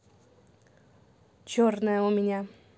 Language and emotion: Russian, neutral